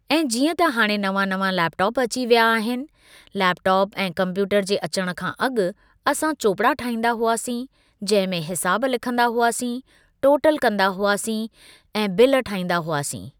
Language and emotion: Sindhi, neutral